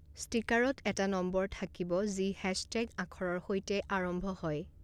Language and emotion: Assamese, neutral